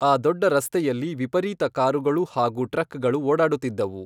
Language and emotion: Kannada, neutral